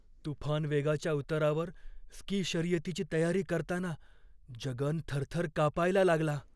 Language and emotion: Marathi, fearful